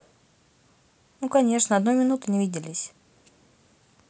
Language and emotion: Russian, neutral